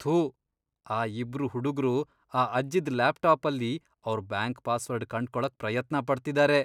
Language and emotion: Kannada, disgusted